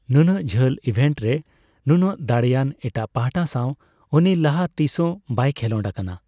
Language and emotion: Santali, neutral